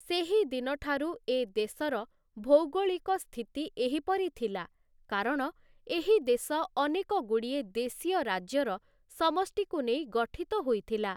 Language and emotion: Odia, neutral